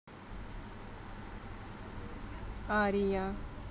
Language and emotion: Russian, neutral